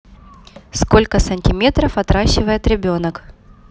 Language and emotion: Russian, neutral